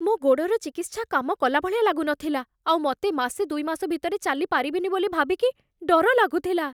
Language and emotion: Odia, fearful